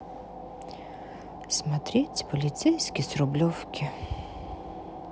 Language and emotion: Russian, sad